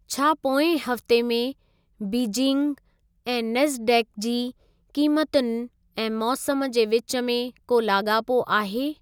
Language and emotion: Sindhi, neutral